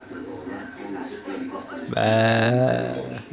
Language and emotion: Russian, positive